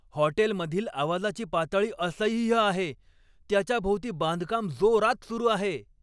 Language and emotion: Marathi, angry